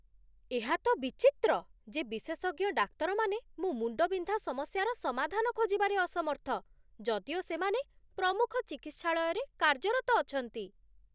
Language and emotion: Odia, surprised